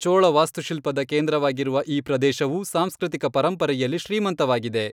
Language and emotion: Kannada, neutral